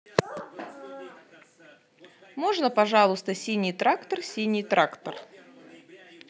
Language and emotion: Russian, positive